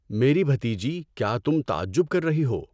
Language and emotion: Urdu, neutral